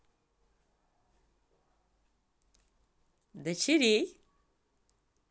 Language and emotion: Russian, positive